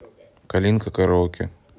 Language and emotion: Russian, neutral